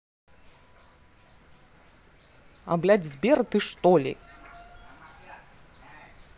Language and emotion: Russian, angry